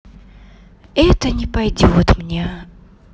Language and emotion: Russian, sad